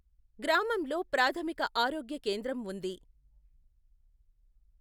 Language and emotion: Telugu, neutral